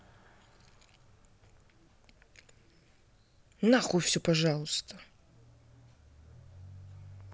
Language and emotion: Russian, angry